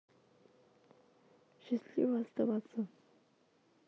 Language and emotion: Russian, sad